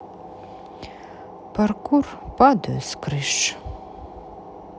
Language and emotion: Russian, sad